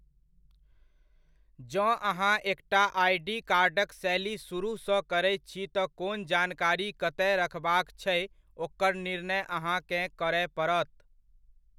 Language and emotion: Maithili, neutral